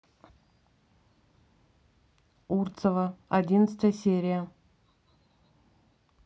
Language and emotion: Russian, neutral